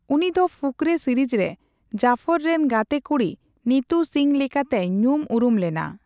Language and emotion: Santali, neutral